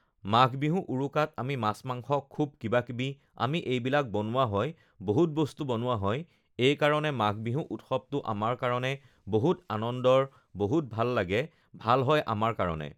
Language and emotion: Assamese, neutral